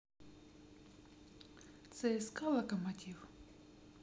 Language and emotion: Russian, neutral